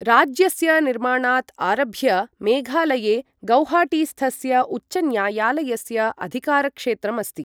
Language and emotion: Sanskrit, neutral